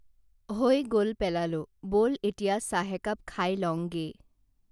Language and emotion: Assamese, neutral